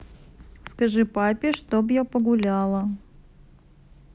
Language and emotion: Russian, neutral